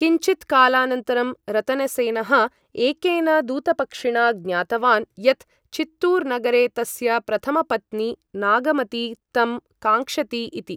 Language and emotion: Sanskrit, neutral